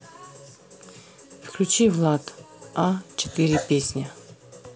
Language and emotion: Russian, neutral